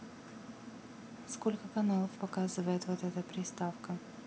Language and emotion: Russian, neutral